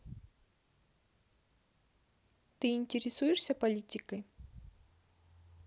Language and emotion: Russian, neutral